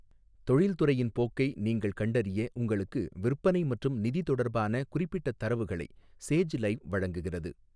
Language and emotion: Tamil, neutral